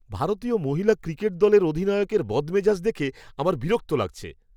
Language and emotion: Bengali, disgusted